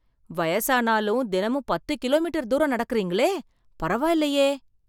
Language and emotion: Tamil, surprised